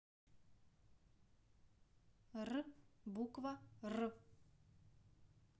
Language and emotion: Russian, neutral